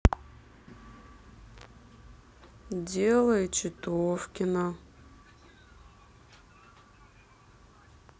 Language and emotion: Russian, neutral